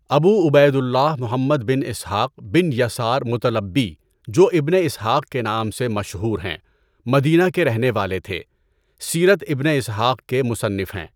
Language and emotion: Urdu, neutral